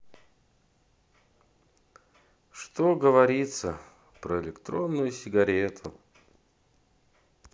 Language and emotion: Russian, sad